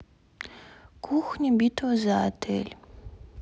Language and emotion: Russian, sad